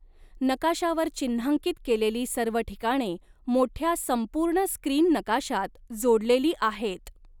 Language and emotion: Marathi, neutral